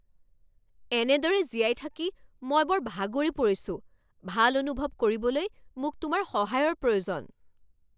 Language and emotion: Assamese, angry